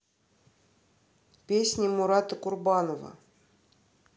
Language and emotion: Russian, neutral